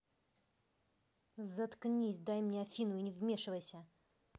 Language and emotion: Russian, angry